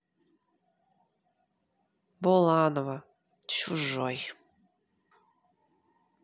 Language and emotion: Russian, sad